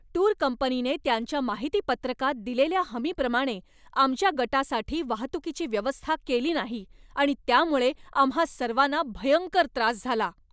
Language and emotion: Marathi, angry